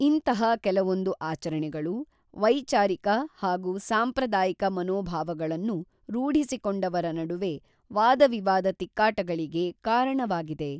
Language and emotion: Kannada, neutral